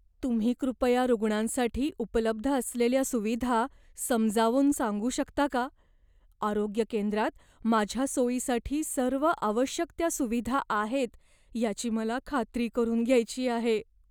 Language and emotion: Marathi, fearful